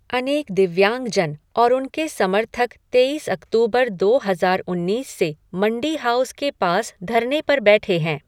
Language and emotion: Hindi, neutral